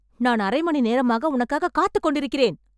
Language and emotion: Tamil, angry